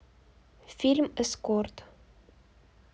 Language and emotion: Russian, neutral